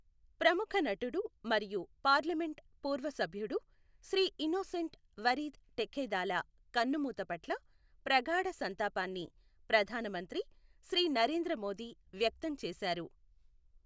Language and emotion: Telugu, neutral